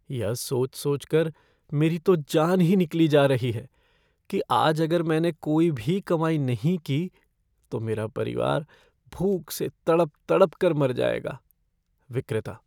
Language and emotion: Hindi, fearful